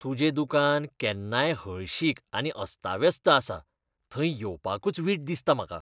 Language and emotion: Goan Konkani, disgusted